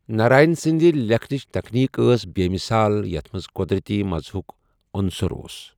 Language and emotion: Kashmiri, neutral